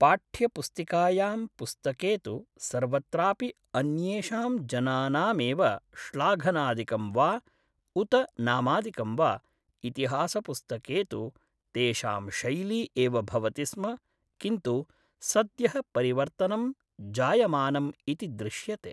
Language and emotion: Sanskrit, neutral